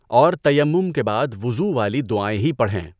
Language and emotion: Urdu, neutral